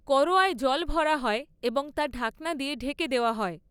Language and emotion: Bengali, neutral